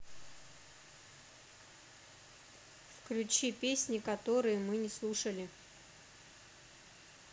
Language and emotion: Russian, neutral